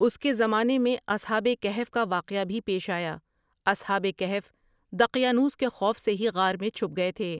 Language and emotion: Urdu, neutral